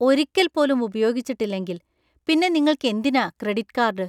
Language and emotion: Malayalam, disgusted